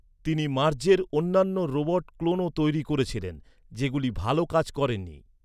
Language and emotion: Bengali, neutral